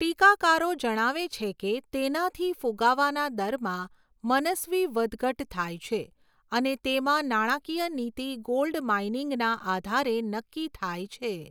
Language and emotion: Gujarati, neutral